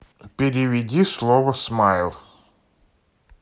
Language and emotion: Russian, neutral